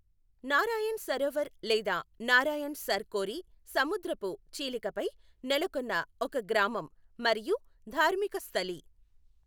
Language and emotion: Telugu, neutral